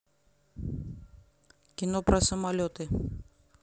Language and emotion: Russian, neutral